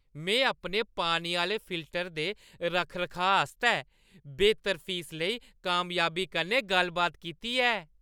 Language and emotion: Dogri, happy